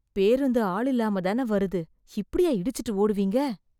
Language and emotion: Tamil, disgusted